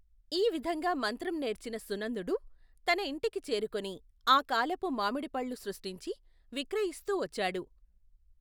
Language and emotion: Telugu, neutral